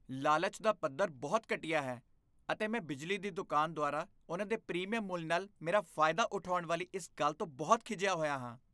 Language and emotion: Punjabi, disgusted